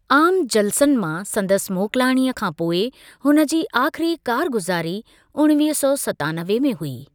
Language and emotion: Sindhi, neutral